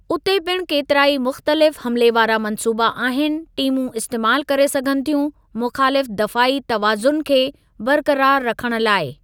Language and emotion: Sindhi, neutral